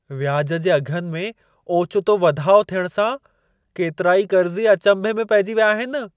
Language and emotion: Sindhi, surprised